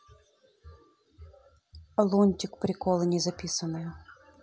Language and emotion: Russian, neutral